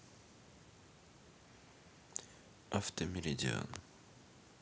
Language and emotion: Russian, neutral